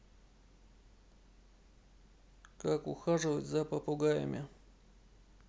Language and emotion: Russian, neutral